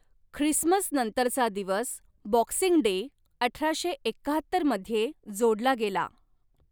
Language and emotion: Marathi, neutral